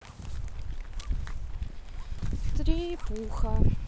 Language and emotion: Russian, sad